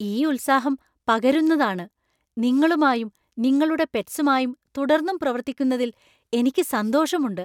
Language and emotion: Malayalam, surprised